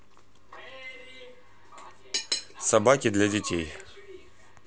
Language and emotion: Russian, neutral